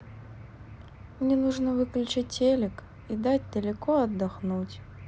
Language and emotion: Russian, sad